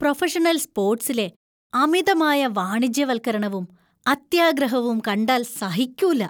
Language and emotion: Malayalam, disgusted